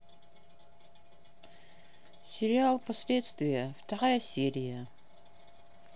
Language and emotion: Russian, neutral